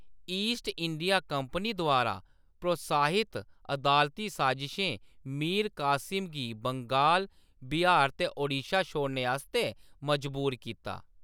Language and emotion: Dogri, neutral